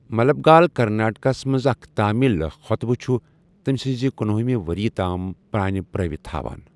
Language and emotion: Kashmiri, neutral